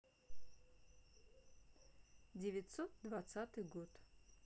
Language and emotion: Russian, neutral